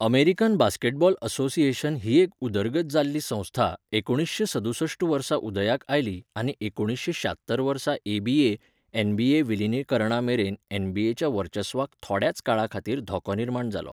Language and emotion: Goan Konkani, neutral